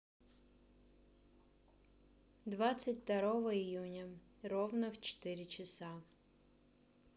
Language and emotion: Russian, neutral